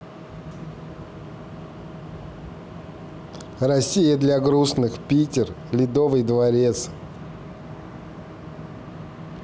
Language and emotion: Russian, neutral